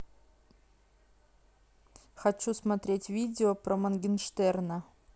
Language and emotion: Russian, neutral